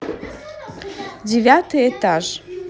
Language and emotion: Russian, positive